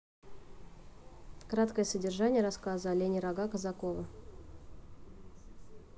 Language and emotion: Russian, neutral